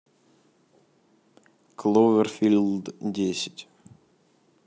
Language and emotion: Russian, neutral